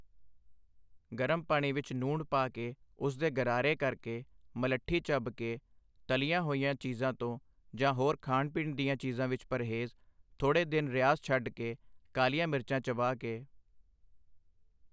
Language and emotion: Punjabi, neutral